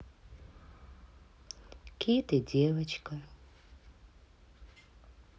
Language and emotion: Russian, sad